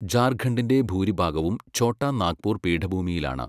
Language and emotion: Malayalam, neutral